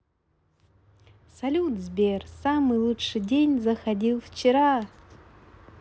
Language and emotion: Russian, positive